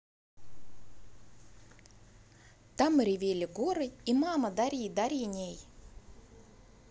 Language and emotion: Russian, positive